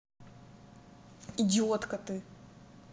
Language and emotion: Russian, angry